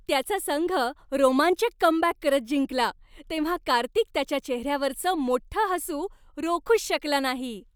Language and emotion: Marathi, happy